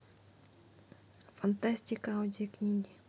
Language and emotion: Russian, neutral